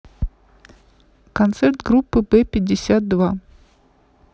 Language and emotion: Russian, neutral